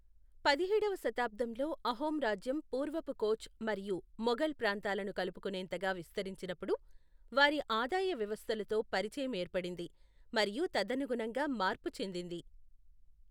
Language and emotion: Telugu, neutral